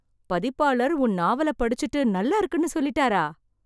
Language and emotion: Tamil, surprised